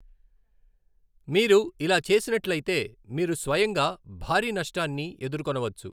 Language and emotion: Telugu, neutral